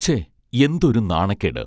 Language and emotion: Malayalam, neutral